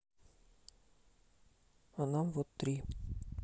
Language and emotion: Russian, neutral